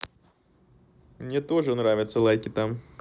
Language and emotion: Russian, neutral